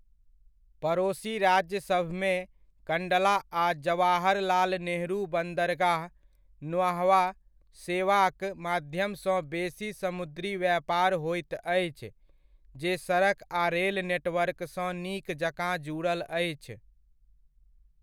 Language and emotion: Maithili, neutral